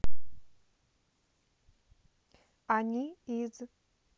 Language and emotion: Russian, neutral